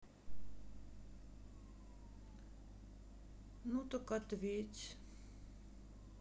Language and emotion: Russian, sad